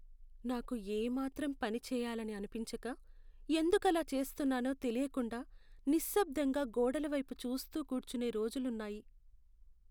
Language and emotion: Telugu, sad